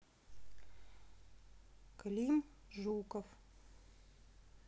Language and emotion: Russian, neutral